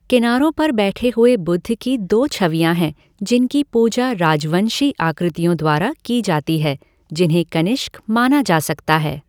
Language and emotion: Hindi, neutral